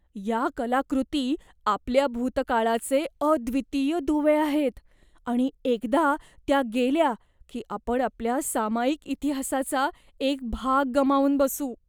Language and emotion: Marathi, fearful